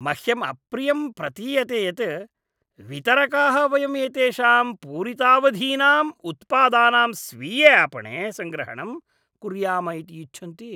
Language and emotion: Sanskrit, disgusted